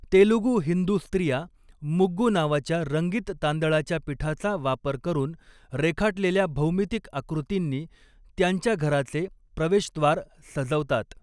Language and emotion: Marathi, neutral